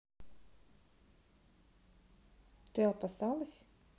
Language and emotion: Russian, neutral